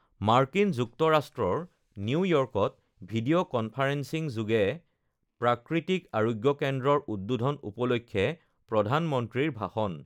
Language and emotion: Assamese, neutral